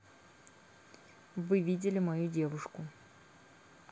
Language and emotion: Russian, neutral